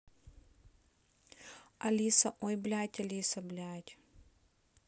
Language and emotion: Russian, angry